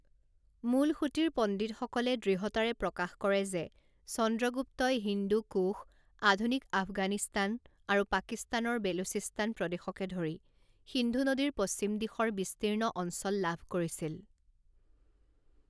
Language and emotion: Assamese, neutral